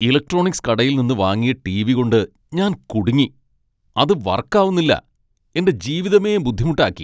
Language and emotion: Malayalam, angry